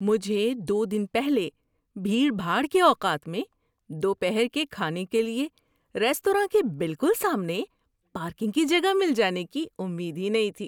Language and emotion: Urdu, surprised